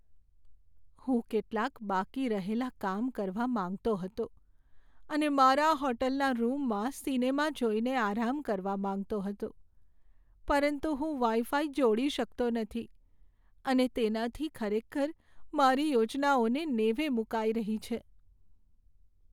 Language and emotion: Gujarati, sad